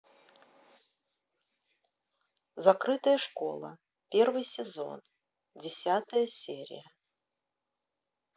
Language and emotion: Russian, neutral